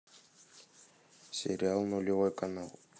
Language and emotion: Russian, neutral